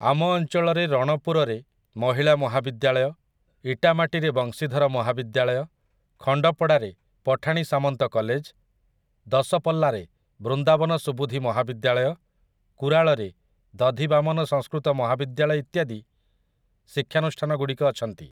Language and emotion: Odia, neutral